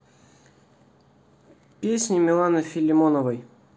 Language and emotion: Russian, neutral